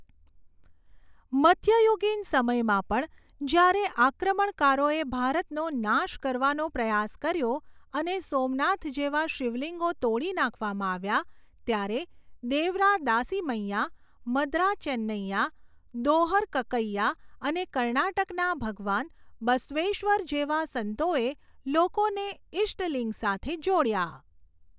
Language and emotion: Gujarati, neutral